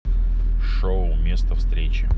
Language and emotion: Russian, neutral